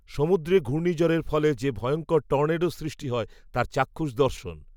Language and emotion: Bengali, neutral